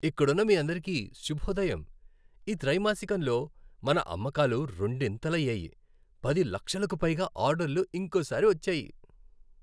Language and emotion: Telugu, happy